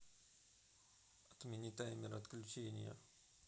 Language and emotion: Russian, neutral